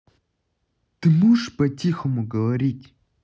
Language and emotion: Russian, angry